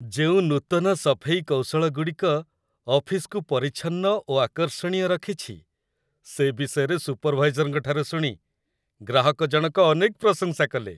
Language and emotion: Odia, happy